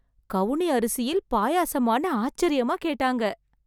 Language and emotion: Tamil, surprised